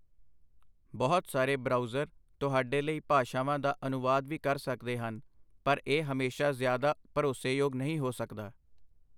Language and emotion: Punjabi, neutral